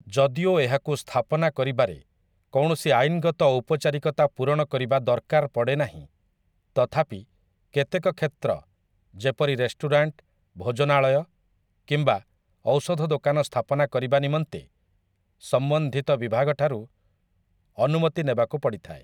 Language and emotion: Odia, neutral